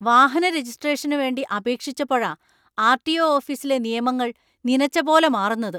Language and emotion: Malayalam, angry